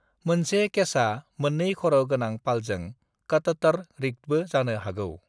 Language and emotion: Bodo, neutral